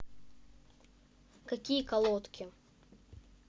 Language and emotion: Russian, neutral